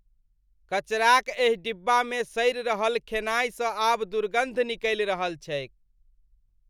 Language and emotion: Maithili, disgusted